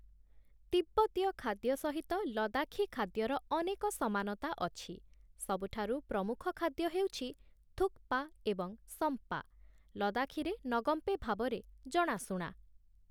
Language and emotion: Odia, neutral